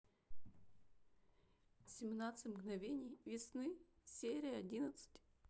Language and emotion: Russian, sad